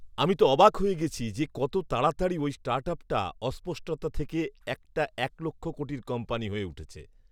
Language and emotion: Bengali, surprised